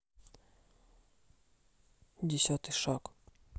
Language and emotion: Russian, neutral